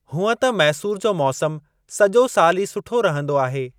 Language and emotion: Sindhi, neutral